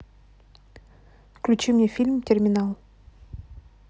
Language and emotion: Russian, neutral